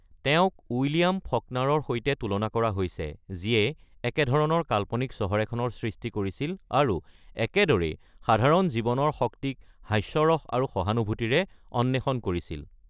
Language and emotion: Assamese, neutral